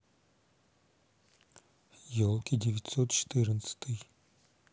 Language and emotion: Russian, neutral